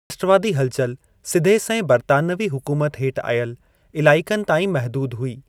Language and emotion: Sindhi, neutral